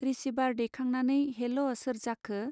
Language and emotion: Bodo, neutral